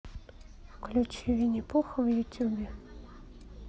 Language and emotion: Russian, neutral